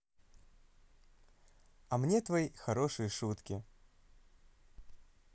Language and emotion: Russian, positive